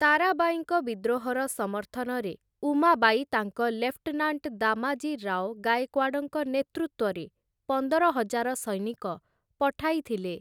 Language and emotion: Odia, neutral